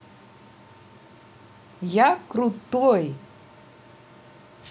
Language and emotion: Russian, positive